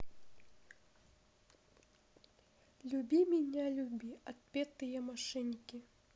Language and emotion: Russian, neutral